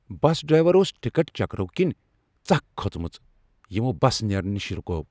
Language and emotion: Kashmiri, angry